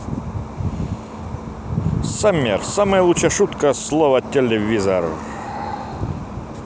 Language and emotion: Russian, positive